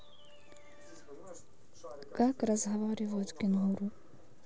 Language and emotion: Russian, neutral